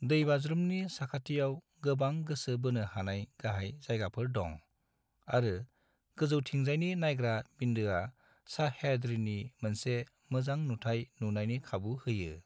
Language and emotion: Bodo, neutral